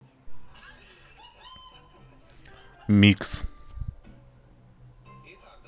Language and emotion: Russian, neutral